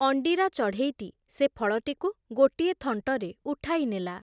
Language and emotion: Odia, neutral